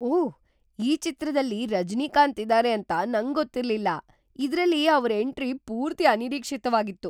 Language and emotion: Kannada, surprised